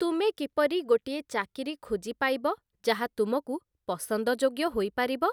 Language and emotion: Odia, neutral